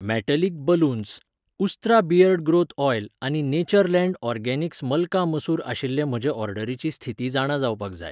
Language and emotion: Goan Konkani, neutral